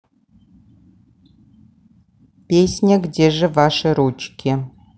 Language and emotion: Russian, neutral